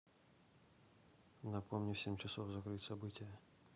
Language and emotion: Russian, neutral